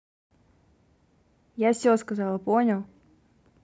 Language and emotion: Russian, angry